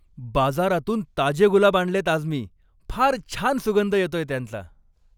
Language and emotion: Marathi, happy